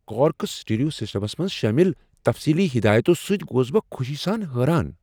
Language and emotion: Kashmiri, surprised